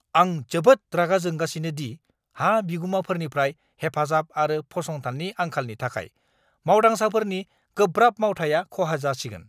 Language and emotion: Bodo, angry